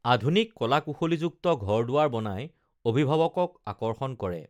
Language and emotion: Assamese, neutral